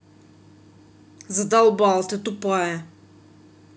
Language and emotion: Russian, angry